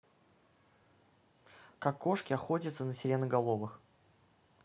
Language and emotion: Russian, neutral